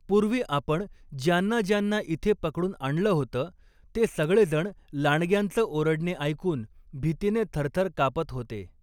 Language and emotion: Marathi, neutral